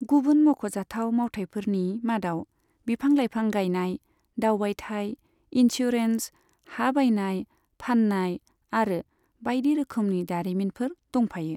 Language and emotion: Bodo, neutral